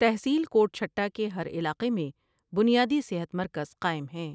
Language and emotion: Urdu, neutral